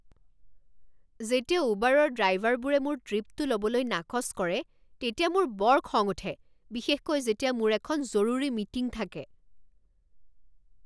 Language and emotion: Assamese, angry